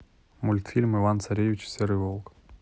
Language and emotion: Russian, neutral